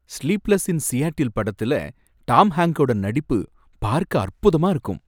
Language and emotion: Tamil, happy